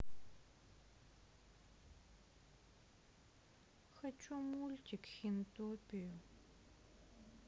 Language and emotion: Russian, sad